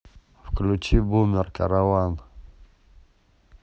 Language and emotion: Russian, neutral